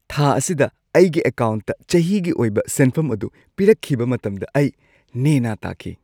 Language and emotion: Manipuri, happy